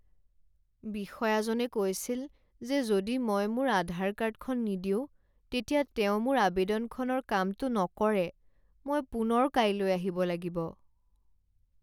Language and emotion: Assamese, sad